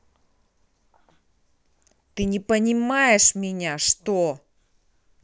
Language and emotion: Russian, angry